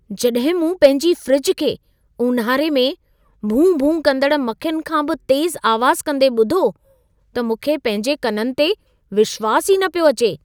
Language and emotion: Sindhi, surprised